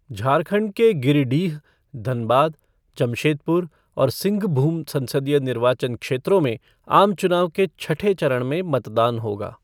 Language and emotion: Hindi, neutral